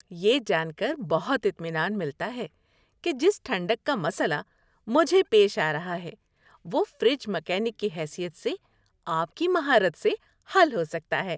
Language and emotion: Urdu, happy